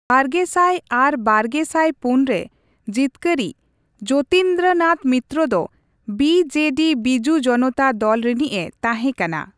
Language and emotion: Santali, neutral